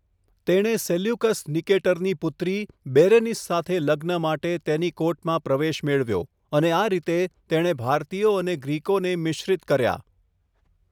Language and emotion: Gujarati, neutral